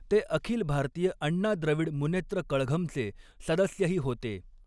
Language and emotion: Marathi, neutral